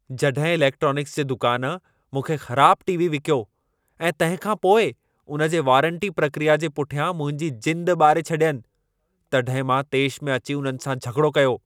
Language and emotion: Sindhi, angry